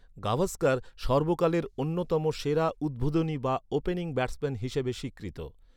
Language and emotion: Bengali, neutral